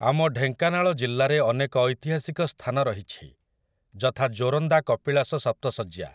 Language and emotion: Odia, neutral